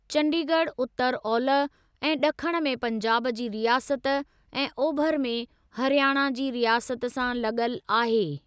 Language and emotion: Sindhi, neutral